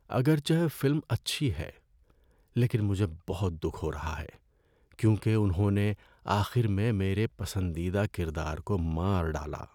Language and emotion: Urdu, sad